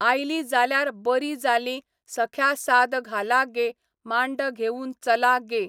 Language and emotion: Goan Konkani, neutral